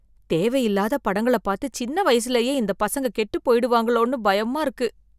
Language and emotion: Tamil, fearful